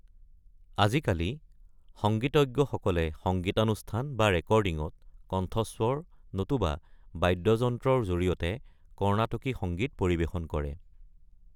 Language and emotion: Assamese, neutral